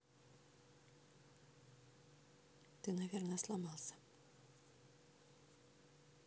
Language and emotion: Russian, neutral